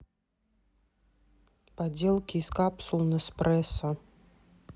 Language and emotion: Russian, neutral